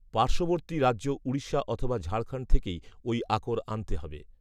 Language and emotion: Bengali, neutral